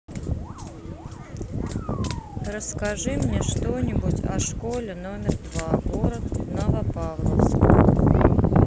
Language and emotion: Russian, neutral